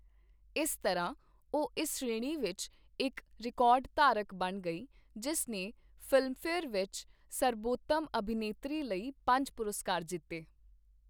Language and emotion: Punjabi, neutral